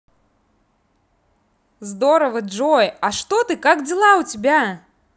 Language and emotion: Russian, positive